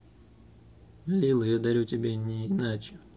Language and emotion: Russian, neutral